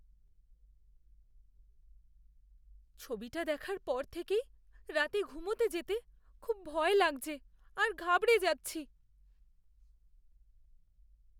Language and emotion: Bengali, fearful